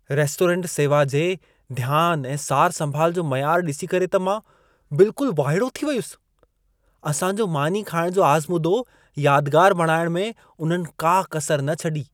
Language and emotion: Sindhi, surprised